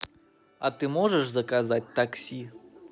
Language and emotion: Russian, positive